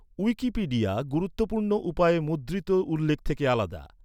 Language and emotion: Bengali, neutral